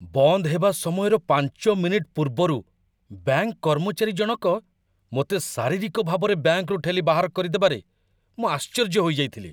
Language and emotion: Odia, surprised